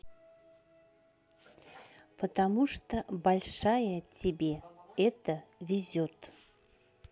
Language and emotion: Russian, neutral